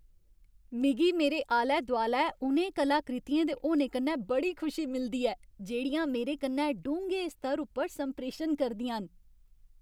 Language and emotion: Dogri, happy